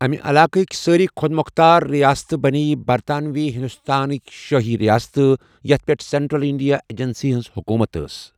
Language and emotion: Kashmiri, neutral